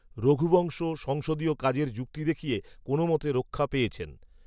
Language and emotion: Bengali, neutral